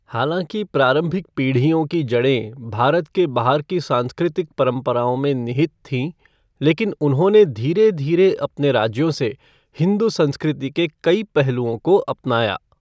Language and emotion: Hindi, neutral